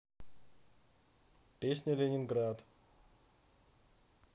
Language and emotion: Russian, neutral